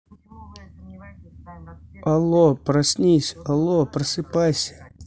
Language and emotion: Russian, neutral